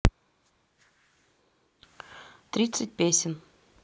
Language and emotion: Russian, neutral